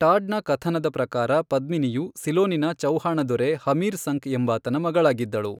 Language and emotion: Kannada, neutral